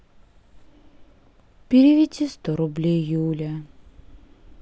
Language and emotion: Russian, sad